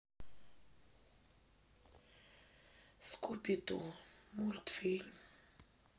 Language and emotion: Russian, sad